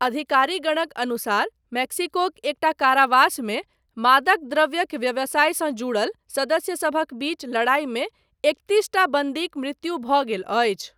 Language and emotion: Maithili, neutral